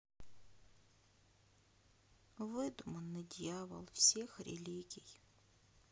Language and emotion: Russian, sad